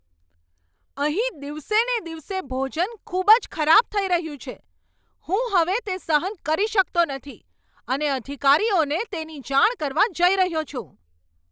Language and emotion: Gujarati, angry